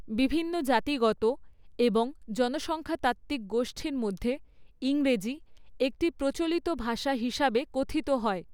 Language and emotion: Bengali, neutral